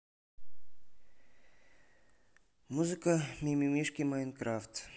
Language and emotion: Russian, neutral